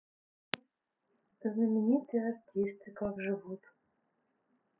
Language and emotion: Russian, neutral